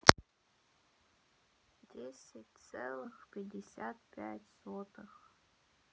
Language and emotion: Russian, sad